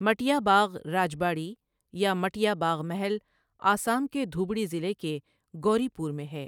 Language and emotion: Urdu, neutral